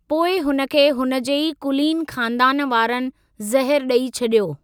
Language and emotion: Sindhi, neutral